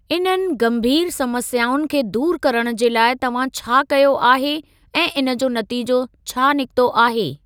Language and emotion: Sindhi, neutral